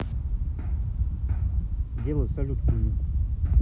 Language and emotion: Russian, neutral